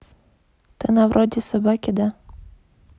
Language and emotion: Russian, neutral